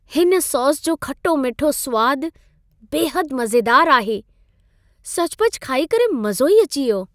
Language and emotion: Sindhi, happy